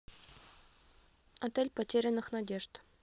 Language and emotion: Russian, neutral